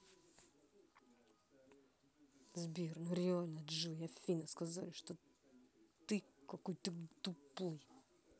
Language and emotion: Russian, angry